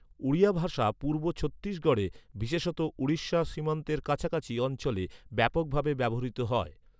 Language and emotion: Bengali, neutral